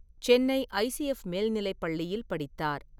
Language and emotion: Tamil, neutral